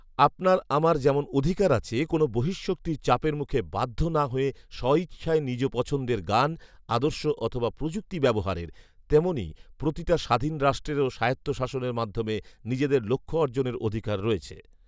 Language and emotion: Bengali, neutral